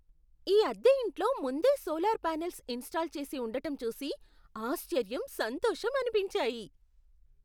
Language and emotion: Telugu, surprised